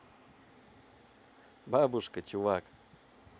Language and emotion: Russian, positive